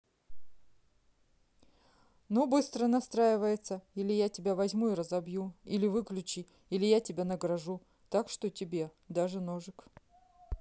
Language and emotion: Russian, neutral